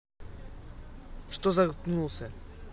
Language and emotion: Russian, angry